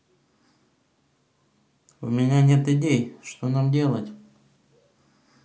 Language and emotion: Russian, neutral